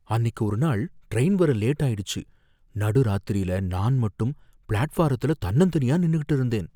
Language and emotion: Tamil, fearful